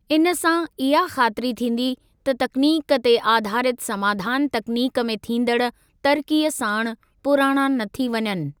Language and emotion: Sindhi, neutral